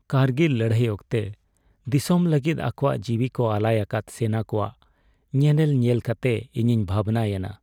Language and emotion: Santali, sad